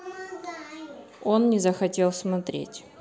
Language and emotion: Russian, neutral